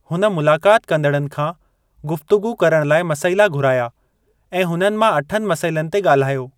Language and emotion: Sindhi, neutral